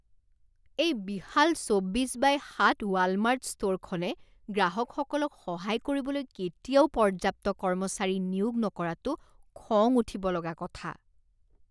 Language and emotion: Assamese, disgusted